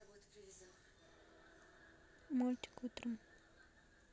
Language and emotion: Russian, neutral